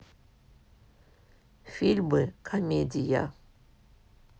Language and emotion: Russian, neutral